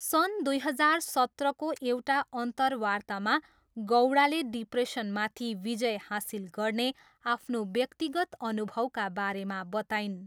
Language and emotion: Nepali, neutral